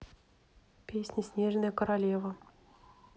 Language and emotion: Russian, neutral